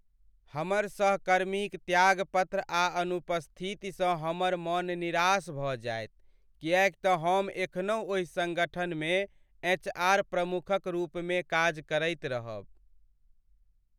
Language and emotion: Maithili, sad